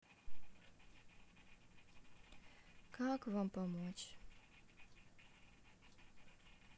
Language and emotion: Russian, sad